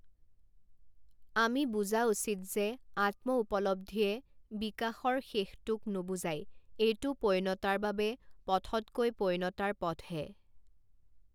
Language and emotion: Assamese, neutral